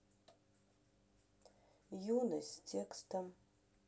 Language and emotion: Russian, neutral